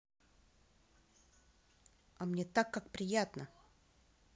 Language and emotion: Russian, angry